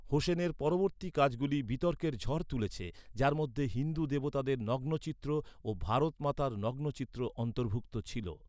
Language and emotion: Bengali, neutral